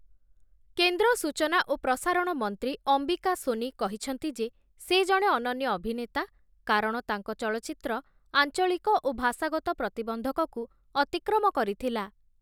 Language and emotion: Odia, neutral